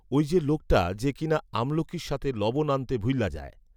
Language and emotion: Bengali, neutral